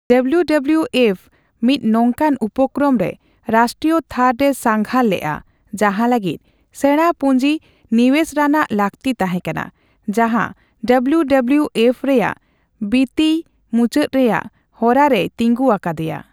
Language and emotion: Santali, neutral